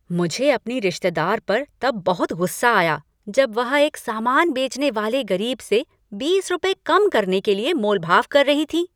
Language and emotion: Hindi, angry